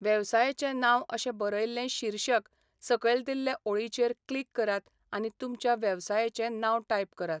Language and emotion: Goan Konkani, neutral